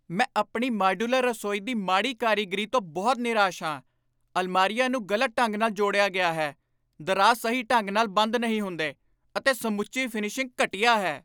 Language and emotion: Punjabi, angry